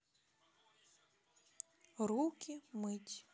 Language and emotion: Russian, neutral